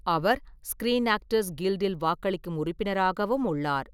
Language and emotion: Tamil, neutral